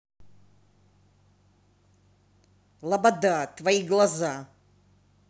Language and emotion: Russian, angry